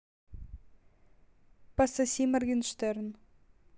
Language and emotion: Russian, neutral